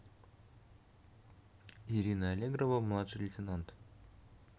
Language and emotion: Russian, neutral